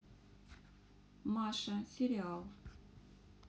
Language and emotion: Russian, neutral